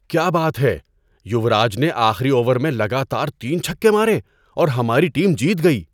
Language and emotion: Urdu, surprised